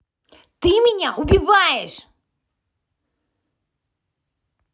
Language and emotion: Russian, angry